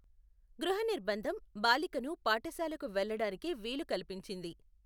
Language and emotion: Telugu, neutral